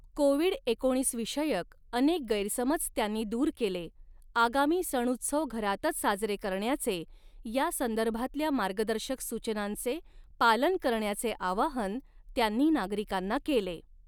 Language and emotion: Marathi, neutral